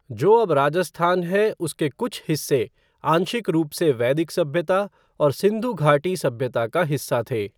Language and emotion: Hindi, neutral